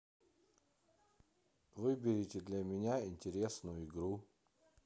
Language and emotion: Russian, neutral